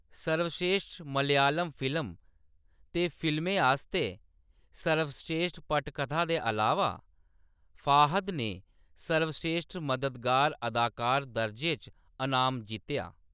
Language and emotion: Dogri, neutral